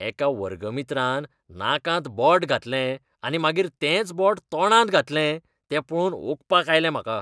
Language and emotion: Goan Konkani, disgusted